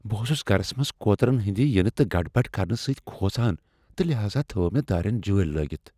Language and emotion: Kashmiri, fearful